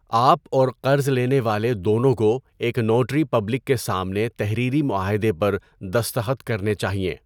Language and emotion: Urdu, neutral